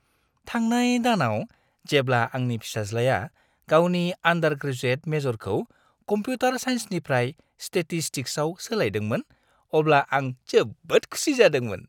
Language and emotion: Bodo, happy